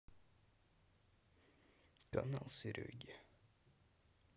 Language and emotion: Russian, sad